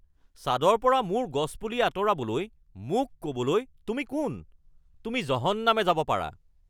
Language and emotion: Assamese, angry